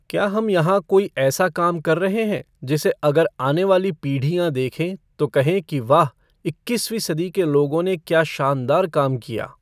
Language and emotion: Hindi, neutral